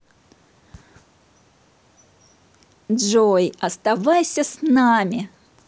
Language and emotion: Russian, positive